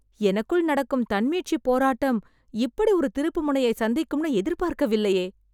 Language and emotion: Tamil, surprised